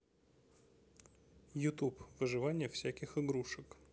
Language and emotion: Russian, neutral